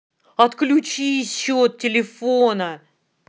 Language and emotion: Russian, angry